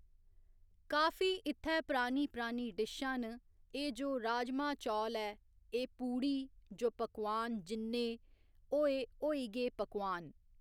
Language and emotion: Dogri, neutral